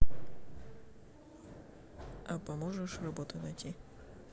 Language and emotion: Russian, neutral